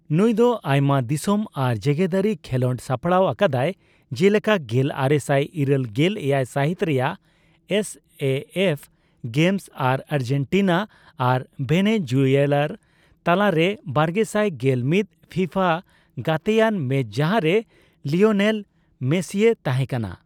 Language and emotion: Santali, neutral